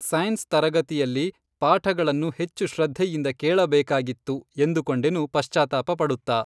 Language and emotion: Kannada, neutral